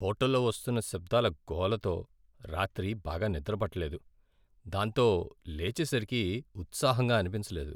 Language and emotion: Telugu, sad